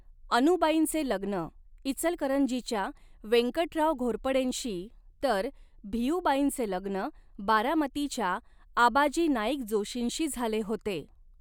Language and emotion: Marathi, neutral